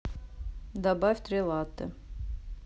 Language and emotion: Russian, neutral